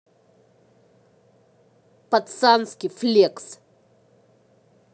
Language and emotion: Russian, angry